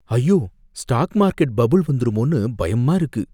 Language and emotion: Tamil, fearful